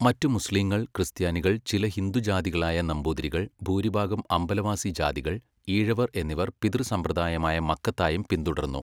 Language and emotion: Malayalam, neutral